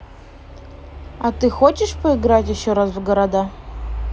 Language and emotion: Russian, neutral